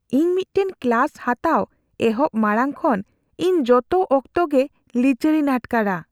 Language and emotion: Santali, fearful